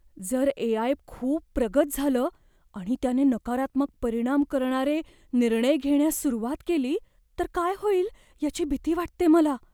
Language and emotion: Marathi, fearful